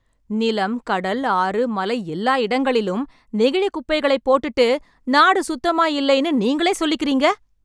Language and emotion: Tamil, angry